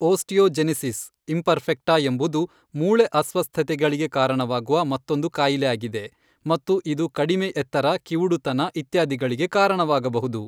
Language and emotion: Kannada, neutral